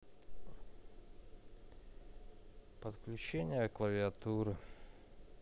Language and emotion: Russian, sad